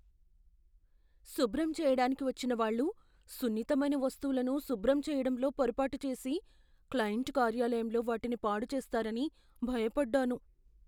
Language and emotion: Telugu, fearful